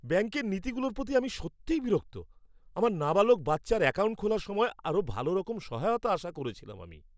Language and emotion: Bengali, angry